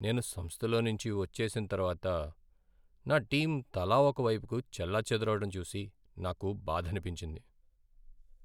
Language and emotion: Telugu, sad